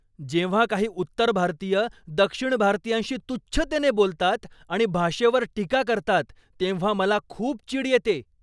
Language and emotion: Marathi, angry